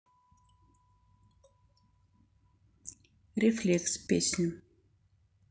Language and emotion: Russian, neutral